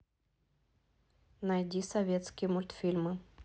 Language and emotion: Russian, neutral